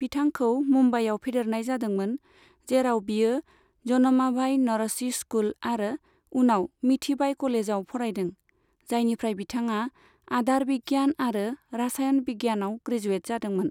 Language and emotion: Bodo, neutral